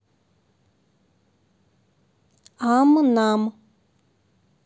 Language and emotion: Russian, neutral